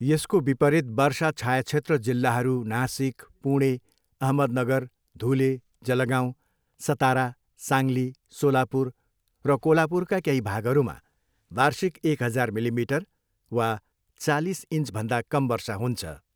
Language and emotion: Nepali, neutral